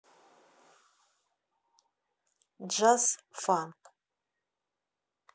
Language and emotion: Russian, neutral